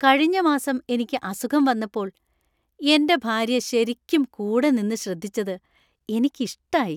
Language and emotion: Malayalam, happy